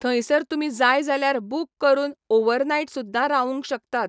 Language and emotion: Goan Konkani, neutral